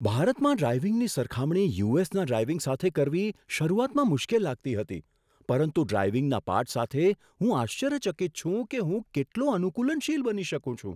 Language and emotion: Gujarati, surprised